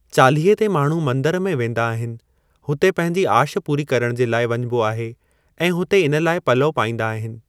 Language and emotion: Sindhi, neutral